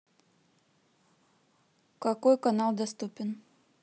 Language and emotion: Russian, neutral